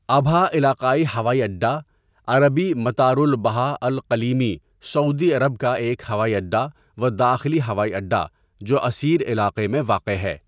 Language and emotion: Urdu, neutral